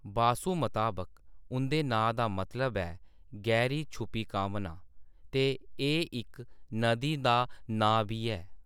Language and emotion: Dogri, neutral